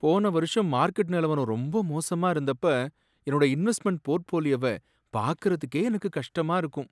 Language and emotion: Tamil, sad